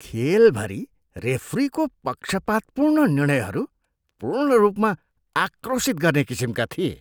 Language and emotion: Nepali, disgusted